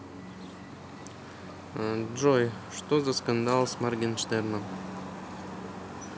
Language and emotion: Russian, neutral